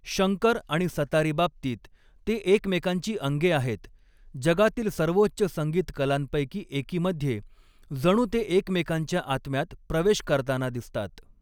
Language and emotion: Marathi, neutral